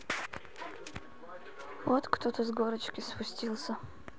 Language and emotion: Russian, neutral